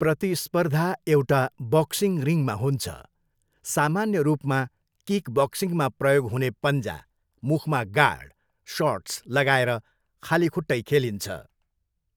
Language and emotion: Nepali, neutral